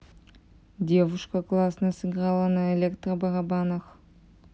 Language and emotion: Russian, neutral